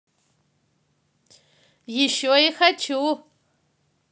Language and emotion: Russian, positive